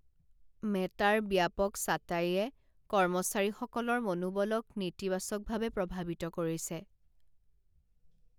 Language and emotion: Assamese, sad